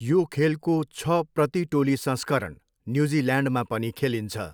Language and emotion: Nepali, neutral